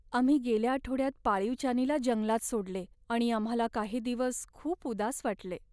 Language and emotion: Marathi, sad